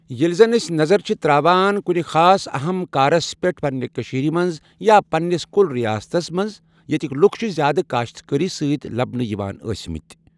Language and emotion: Kashmiri, neutral